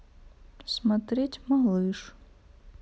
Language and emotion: Russian, sad